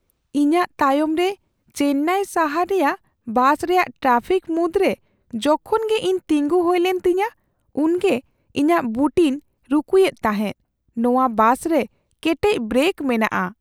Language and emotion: Santali, fearful